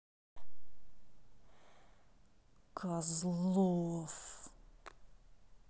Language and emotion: Russian, angry